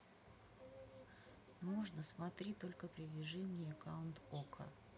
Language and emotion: Russian, neutral